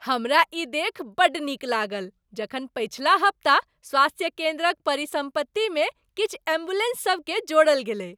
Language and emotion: Maithili, happy